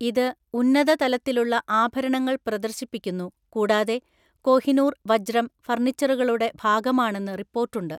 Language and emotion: Malayalam, neutral